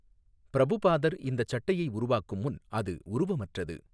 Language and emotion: Tamil, neutral